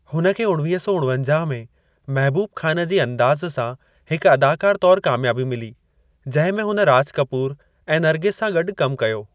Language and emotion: Sindhi, neutral